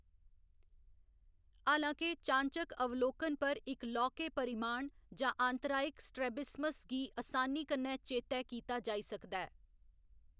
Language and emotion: Dogri, neutral